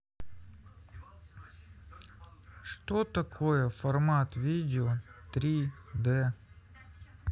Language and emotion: Russian, neutral